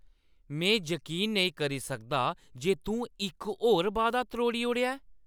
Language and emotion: Dogri, angry